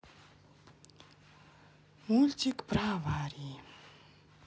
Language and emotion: Russian, sad